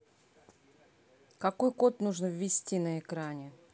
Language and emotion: Russian, angry